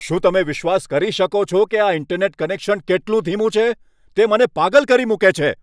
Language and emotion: Gujarati, angry